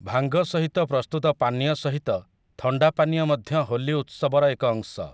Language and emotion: Odia, neutral